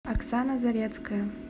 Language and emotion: Russian, neutral